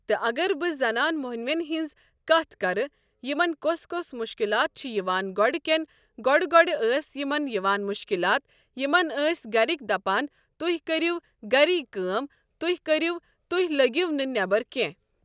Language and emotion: Kashmiri, neutral